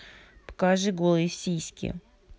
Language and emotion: Russian, neutral